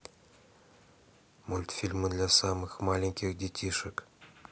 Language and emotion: Russian, neutral